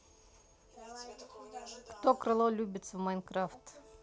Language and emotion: Russian, neutral